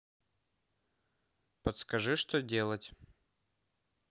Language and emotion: Russian, neutral